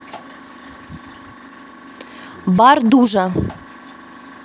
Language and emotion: Russian, angry